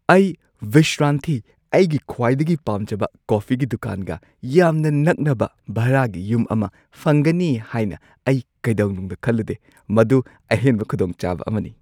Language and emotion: Manipuri, surprised